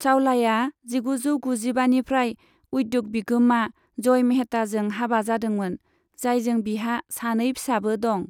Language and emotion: Bodo, neutral